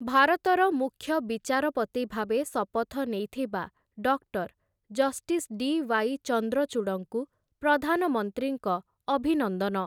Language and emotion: Odia, neutral